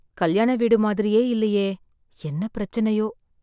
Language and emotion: Tamil, sad